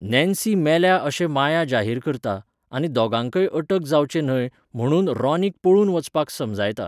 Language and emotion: Goan Konkani, neutral